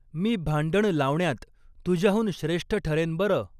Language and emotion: Marathi, neutral